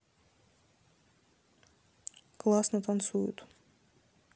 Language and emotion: Russian, neutral